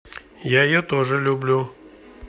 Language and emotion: Russian, neutral